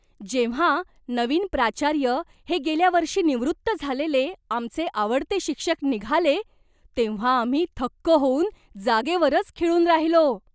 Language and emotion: Marathi, surprised